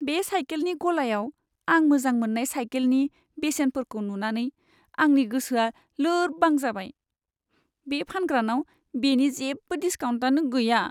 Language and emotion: Bodo, sad